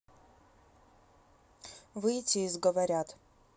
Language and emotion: Russian, neutral